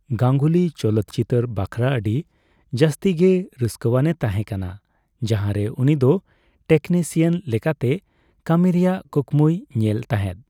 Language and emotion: Santali, neutral